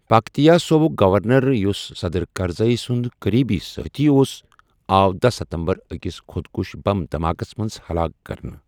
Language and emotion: Kashmiri, neutral